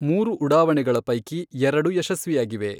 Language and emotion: Kannada, neutral